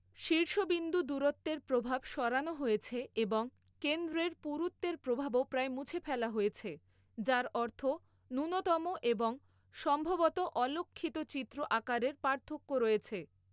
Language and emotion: Bengali, neutral